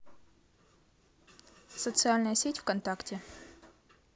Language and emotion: Russian, neutral